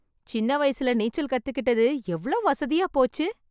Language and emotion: Tamil, happy